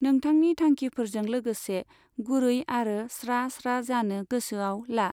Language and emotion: Bodo, neutral